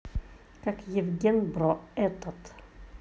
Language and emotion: Russian, neutral